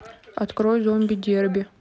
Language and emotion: Russian, neutral